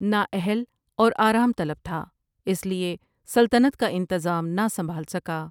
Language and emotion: Urdu, neutral